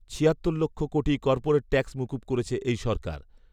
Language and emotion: Bengali, neutral